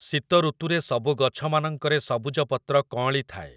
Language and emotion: Odia, neutral